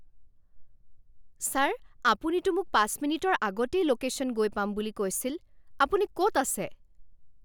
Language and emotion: Assamese, angry